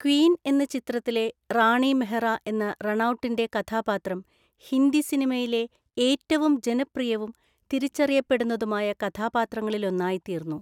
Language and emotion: Malayalam, neutral